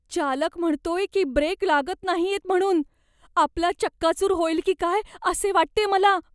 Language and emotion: Marathi, fearful